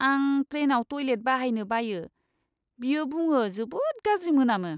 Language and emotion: Bodo, disgusted